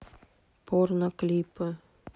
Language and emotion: Russian, neutral